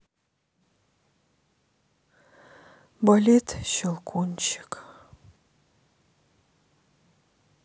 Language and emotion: Russian, sad